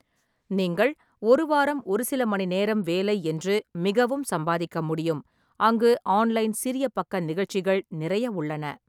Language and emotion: Tamil, neutral